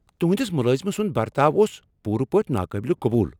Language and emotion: Kashmiri, angry